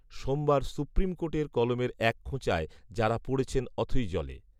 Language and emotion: Bengali, neutral